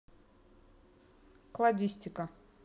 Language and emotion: Russian, neutral